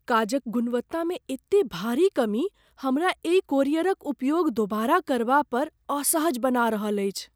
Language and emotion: Maithili, fearful